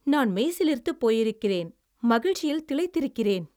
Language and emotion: Tamil, happy